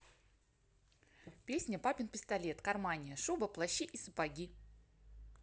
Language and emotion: Russian, positive